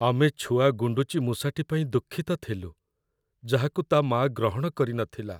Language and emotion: Odia, sad